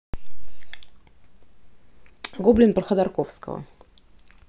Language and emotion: Russian, neutral